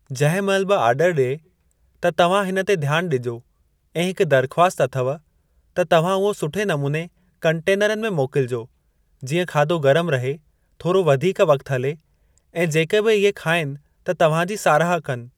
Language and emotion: Sindhi, neutral